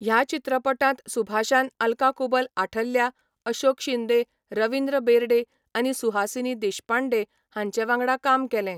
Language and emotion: Goan Konkani, neutral